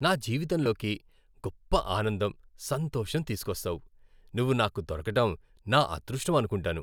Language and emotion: Telugu, happy